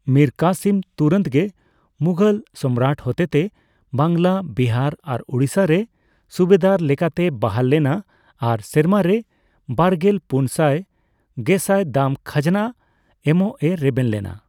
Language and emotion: Santali, neutral